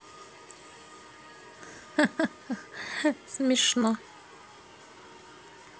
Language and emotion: Russian, positive